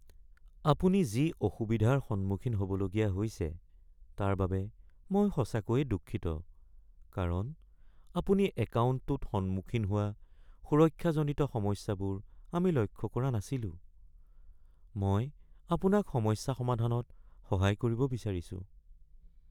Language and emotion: Assamese, sad